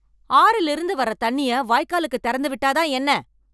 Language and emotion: Tamil, angry